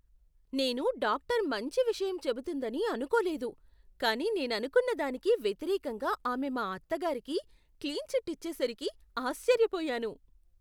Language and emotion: Telugu, surprised